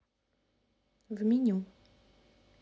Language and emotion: Russian, neutral